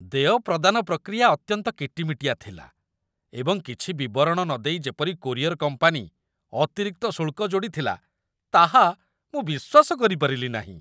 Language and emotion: Odia, disgusted